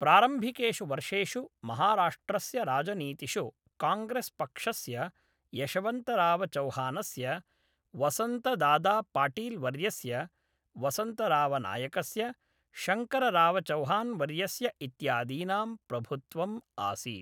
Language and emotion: Sanskrit, neutral